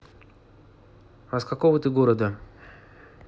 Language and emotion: Russian, neutral